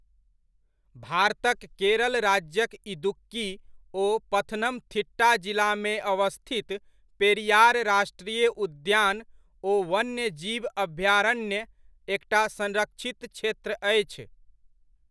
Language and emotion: Maithili, neutral